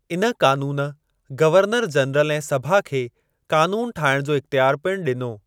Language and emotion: Sindhi, neutral